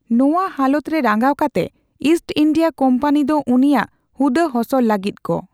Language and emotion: Santali, neutral